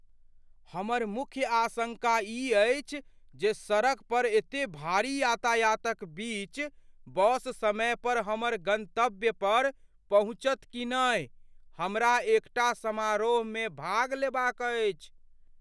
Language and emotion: Maithili, fearful